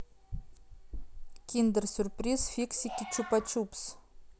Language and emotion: Russian, neutral